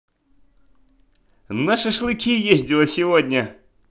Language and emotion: Russian, positive